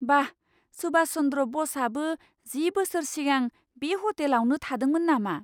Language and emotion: Bodo, surprised